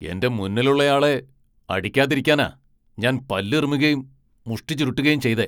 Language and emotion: Malayalam, angry